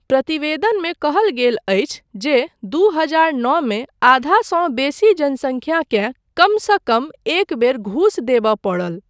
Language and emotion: Maithili, neutral